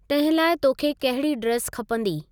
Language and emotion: Sindhi, neutral